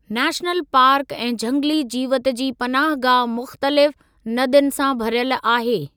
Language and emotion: Sindhi, neutral